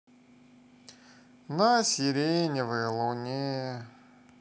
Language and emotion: Russian, sad